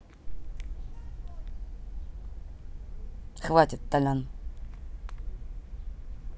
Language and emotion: Russian, neutral